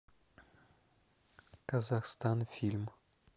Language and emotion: Russian, neutral